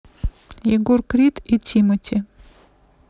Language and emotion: Russian, neutral